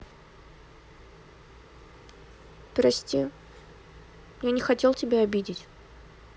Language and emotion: Russian, sad